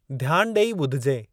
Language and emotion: Sindhi, neutral